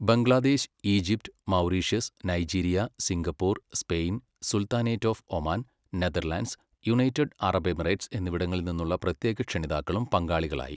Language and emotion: Malayalam, neutral